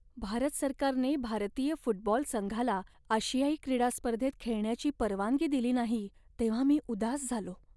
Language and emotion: Marathi, sad